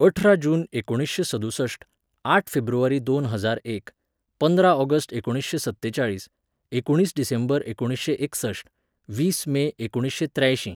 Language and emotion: Goan Konkani, neutral